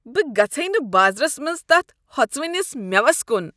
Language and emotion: Kashmiri, disgusted